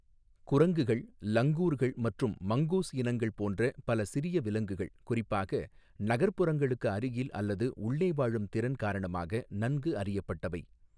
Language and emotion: Tamil, neutral